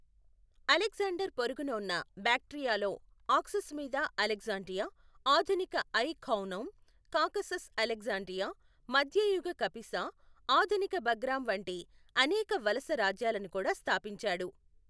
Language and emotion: Telugu, neutral